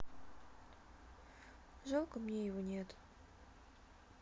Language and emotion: Russian, sad